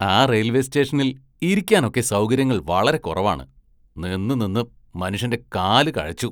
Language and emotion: Malayalam, disgusted